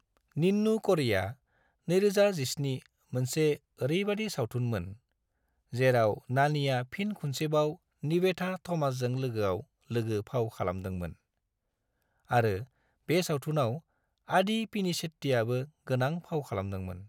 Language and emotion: Bodo, neutral